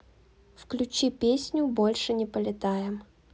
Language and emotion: Russian, neutral